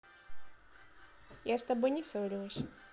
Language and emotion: Russian, neutral